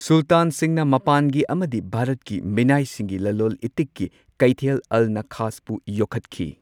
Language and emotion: Manipuri, neutral